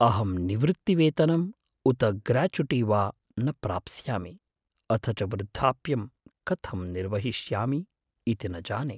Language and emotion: Sanskrit, fearful